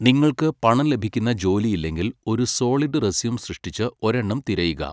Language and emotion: Malayalam, neutral